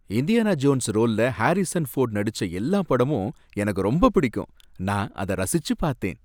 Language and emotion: Tamil, happy